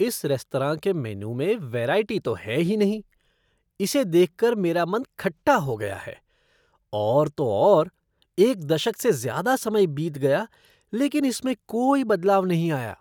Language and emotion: Hindi, disgusted